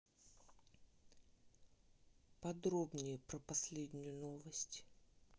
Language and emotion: Russian, neutral